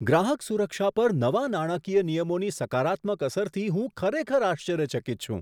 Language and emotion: Gujarati, surprised